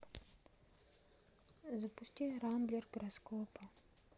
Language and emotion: Russian, neutral